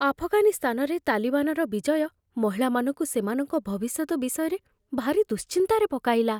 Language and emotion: Odia, fearful